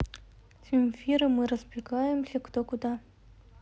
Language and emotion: Russian, neutral